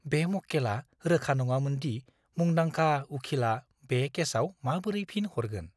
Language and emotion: Bodo, fearful